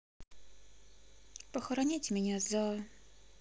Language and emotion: Russian, sad